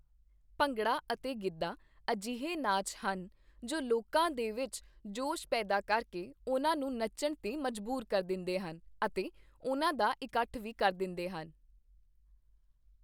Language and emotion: Punjabi, neutral